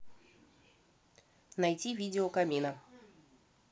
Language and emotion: Russian, neutral